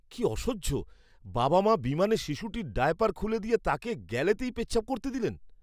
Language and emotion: Bengali, disgusted